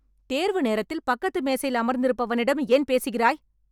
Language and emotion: Tamil, angry